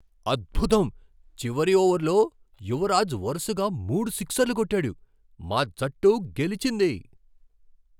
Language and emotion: Telugu, surprised